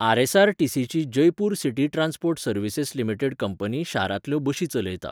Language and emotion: Goan Konkani, neutral